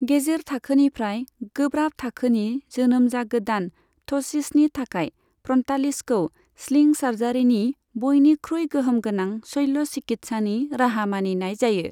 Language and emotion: Bodo, neutral